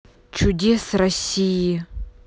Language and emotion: Russian, neutral